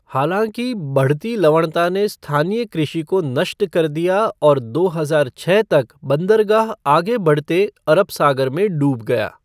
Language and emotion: Hindi, neutral